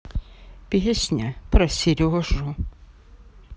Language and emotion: Russian, sad